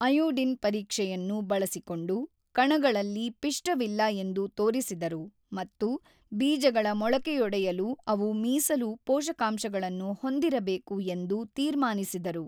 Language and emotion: Kannada, neutral